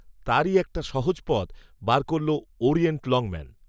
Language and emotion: Bengali, neutral